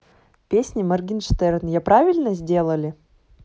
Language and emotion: Russian, neutral